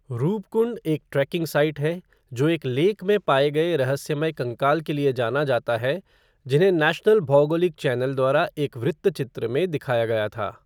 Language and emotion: Hindi, neutral